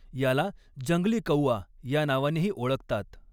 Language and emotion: Marathi, neutral